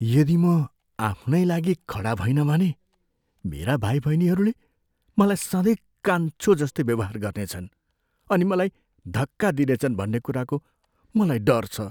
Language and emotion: Nepali, fearful